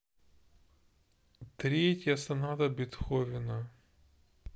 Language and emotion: Russian, sad